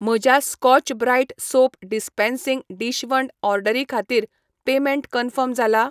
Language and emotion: Goan Konkani, neutral